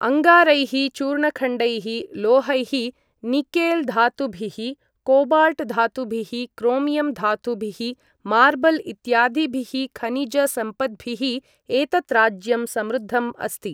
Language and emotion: Sanskrit, neutral